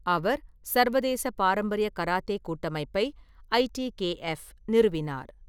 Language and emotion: Tamil, neutral